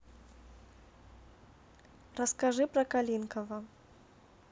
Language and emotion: Russian, neutral